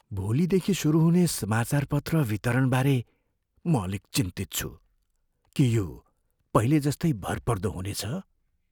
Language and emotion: Nepali, fearful